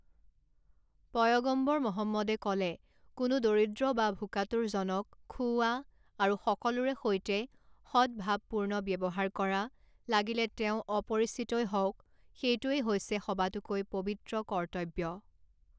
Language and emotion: Assamese, neutral